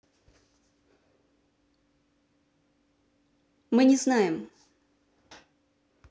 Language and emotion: Russian, neutral